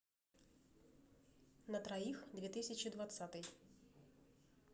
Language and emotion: Russian, neutral